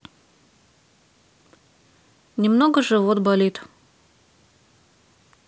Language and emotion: Russian, neutral